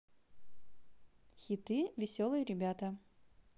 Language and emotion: Russian, positive